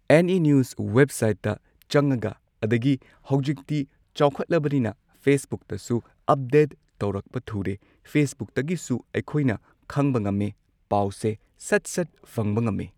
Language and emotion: Manipuri, neutral